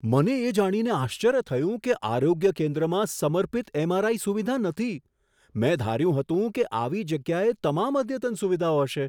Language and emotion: Gujarati, surprised